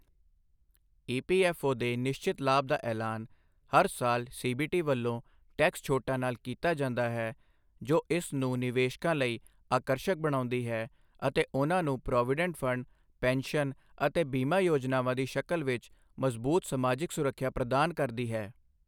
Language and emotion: Punjabi, neutral